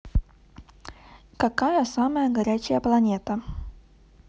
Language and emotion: Russian, neutral